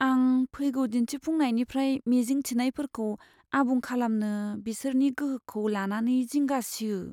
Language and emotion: Bodo, fearful